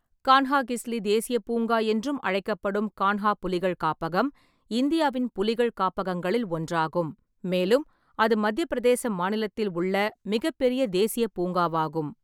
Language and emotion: Tamil, neutral